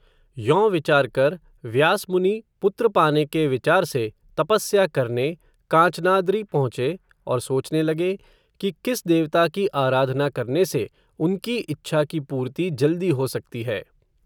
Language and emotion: Hindi, neutral